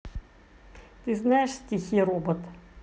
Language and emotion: Russian, neutral